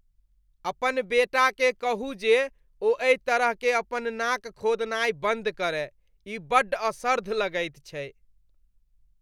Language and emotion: Maithili, disgusted